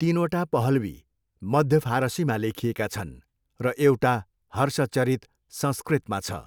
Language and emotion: Nepali, neutral